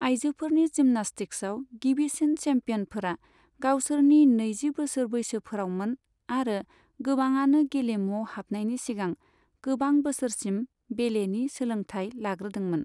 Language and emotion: Bodo, neutral